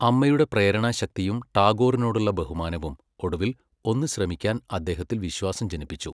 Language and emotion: Malayalam, neutral